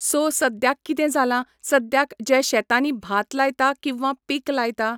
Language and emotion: Goan Konkani, neutral